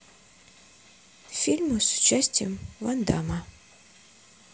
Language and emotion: Russian, neutral